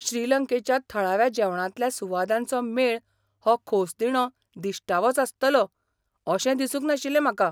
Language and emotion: Goan Konkani, surprised